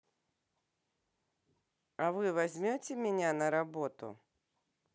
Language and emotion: Russian, neutral